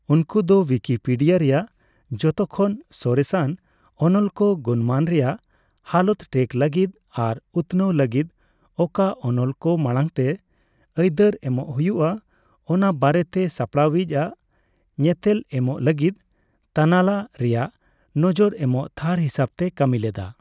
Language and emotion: Santali, neutral